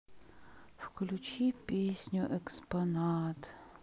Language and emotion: Russian, sad